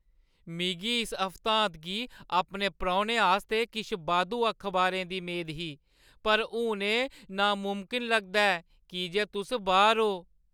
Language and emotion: Dogri, sad